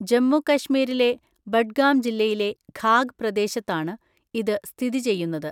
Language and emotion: Malayalam, neutral